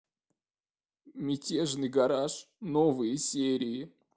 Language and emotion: Russian, sad